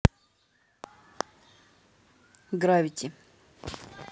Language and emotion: Russian, neutral